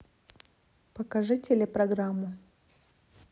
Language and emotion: Russian, neutral